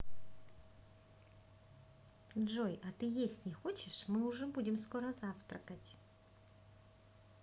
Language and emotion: Russian, positive